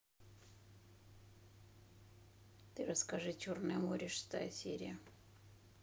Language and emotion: Russian, neutral